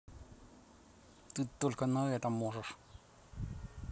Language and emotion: Russian, angry